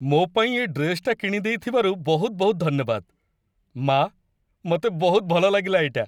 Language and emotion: Odia, happy